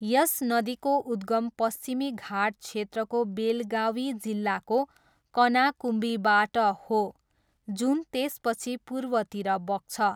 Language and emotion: Nepali, neutral